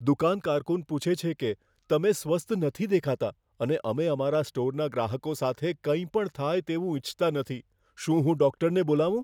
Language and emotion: Gujarati, fearful